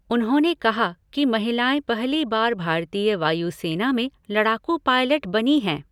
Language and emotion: Hindi, neutral